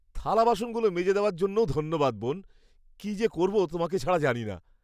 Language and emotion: Bengali, happy